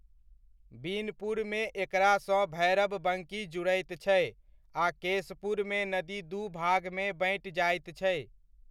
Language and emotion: Maithili, neutral